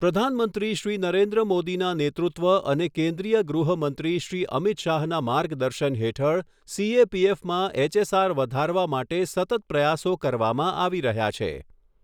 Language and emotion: Gujarati, neutral